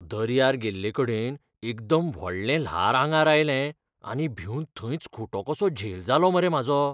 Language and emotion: Goan Konkani, fearful